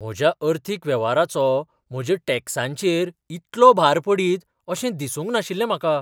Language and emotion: Goan Konkani, surprised